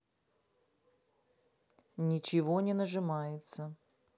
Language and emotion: Russian, neutral